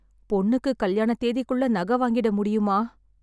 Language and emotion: Tamil, sad